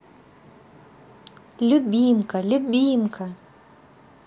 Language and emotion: Russian, positive